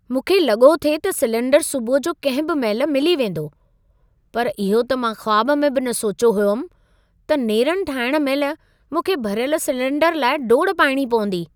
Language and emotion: Sindhi, surprised